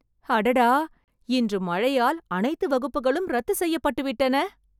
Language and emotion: Tamil, surprised